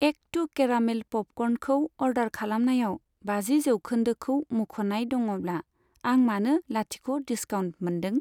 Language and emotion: Bodo, neutral